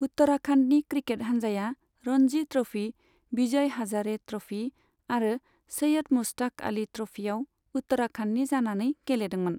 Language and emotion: Bodo, neutral